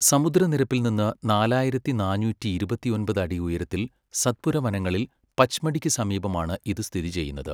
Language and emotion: Malayalam, neutral